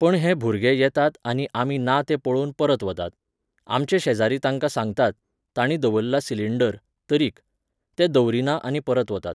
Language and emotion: Goan Konkani, neutral